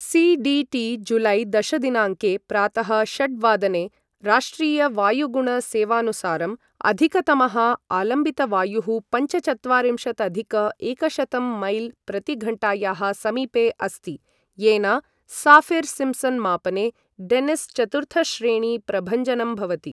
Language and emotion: Sanskrit, neutral